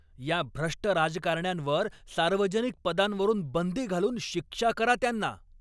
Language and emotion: Marathi, angry